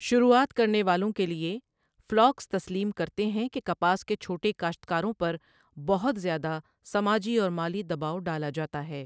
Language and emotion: Urdu, neutral